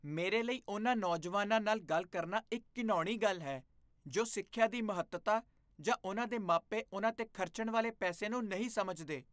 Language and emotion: Punjabi, disgusted